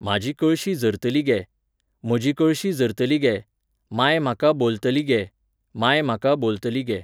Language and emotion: Goan Konkani, neutral